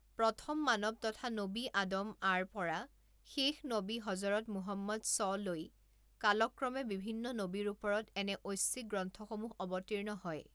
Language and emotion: Assamese, neutral